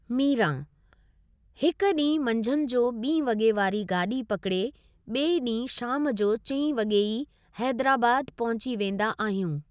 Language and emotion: Sindhi, neutral